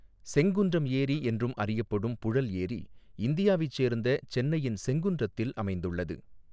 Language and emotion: Tamil, neutral